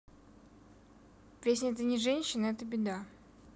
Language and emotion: Russian, neutral